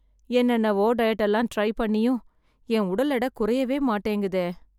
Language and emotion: Tamil, sad